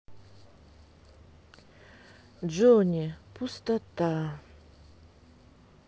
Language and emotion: Russian, sad